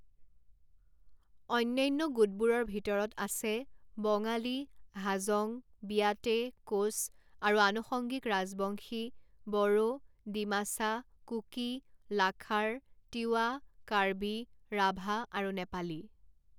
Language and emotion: Assamese, neutral